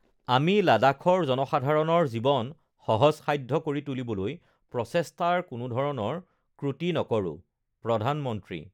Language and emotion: Assamese, neutral